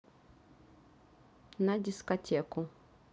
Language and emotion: Russian, neutral